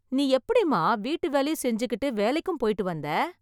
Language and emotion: Tamil, surprised